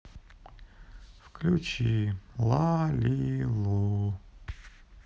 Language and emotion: Russian, sad